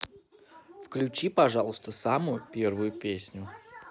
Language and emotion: Russian, positive